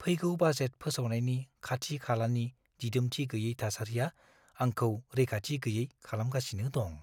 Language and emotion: Bodo, fearful